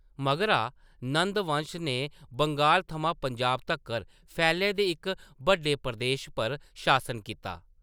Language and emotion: Dogri, neutral